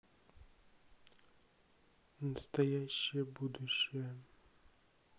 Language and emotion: Russian, sad